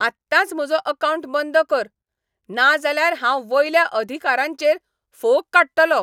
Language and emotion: Goan Konkani, angry